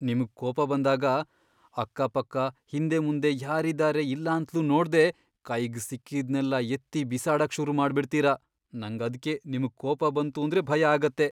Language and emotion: Kannada, fearful